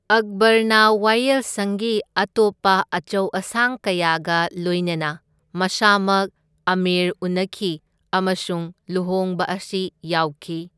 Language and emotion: Manipuri, neutral